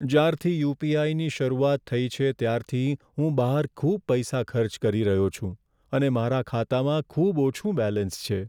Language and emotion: Gujarati, sad